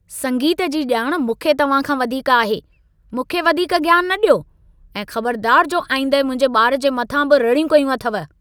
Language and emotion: Sindhi, angry